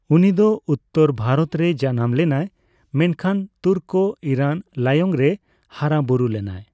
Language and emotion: Santali, neutral